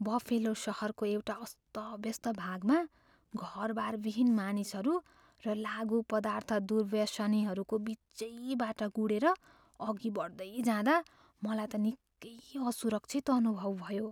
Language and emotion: Nepali, fearful